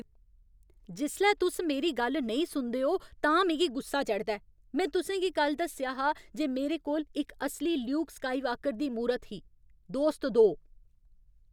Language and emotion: Dogri, angry